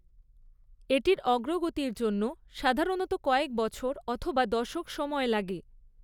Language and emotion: Bengali, neutral